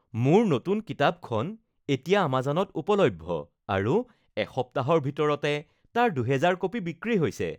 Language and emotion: Assamese, happy